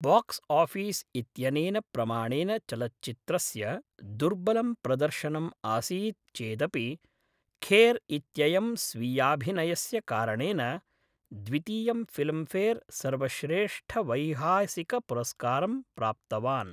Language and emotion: Sanskrit, neutral